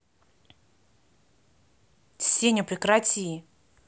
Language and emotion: Russian, angry